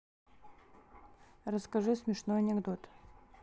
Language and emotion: Russian, neutral